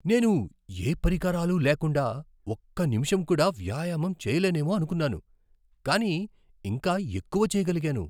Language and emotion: Telugu, surprised